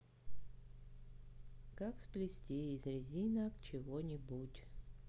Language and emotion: Russian, neutral